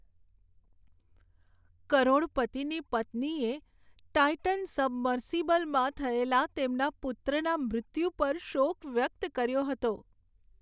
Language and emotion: Gujarati, sad